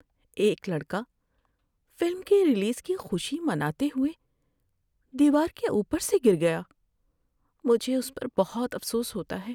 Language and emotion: Urdu, sad